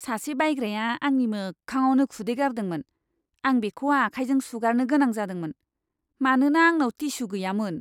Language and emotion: Bodo, disgusted